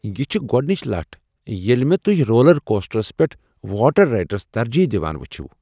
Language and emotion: Kashmiri, surprised